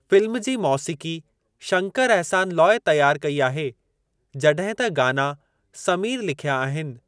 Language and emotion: Sindhi, neutral